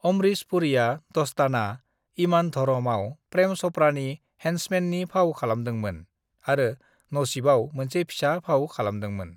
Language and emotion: Bodo, neutral